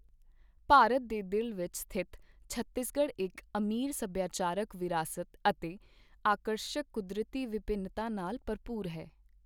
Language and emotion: Punjabi, neutral